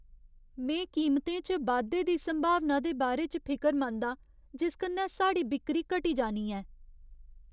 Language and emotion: Dogri, fearful